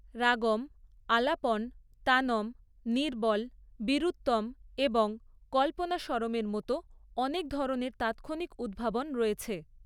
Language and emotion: Bengali, neutral